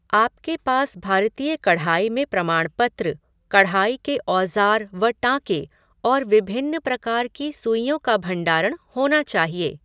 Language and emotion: Hindi, neutral